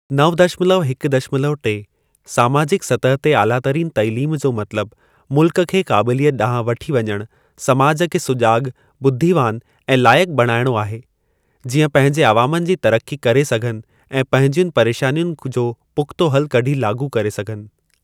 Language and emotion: Sindhi, neutral